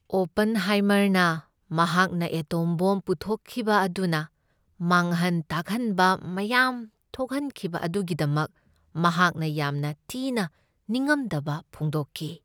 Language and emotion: Manipuri, sad